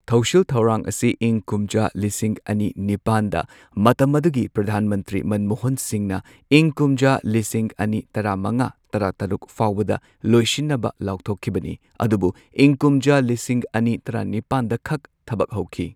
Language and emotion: Manipuri, neutral